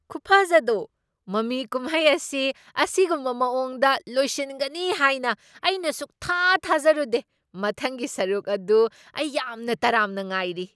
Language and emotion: Manipuri, surprised